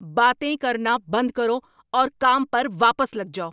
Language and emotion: Urdu, angry